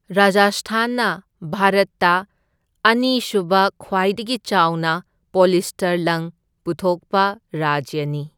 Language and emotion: Manipuri, neutral